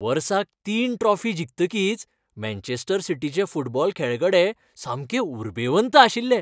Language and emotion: Goan Konkani, happy